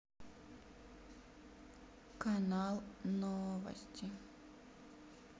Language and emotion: Russian, sad